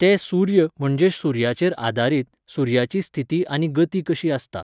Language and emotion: Goan Konkani, neutral